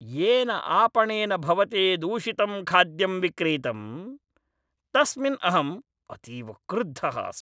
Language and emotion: Sanskrit, angry